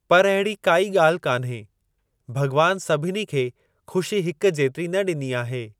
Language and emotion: Sindhi, neutral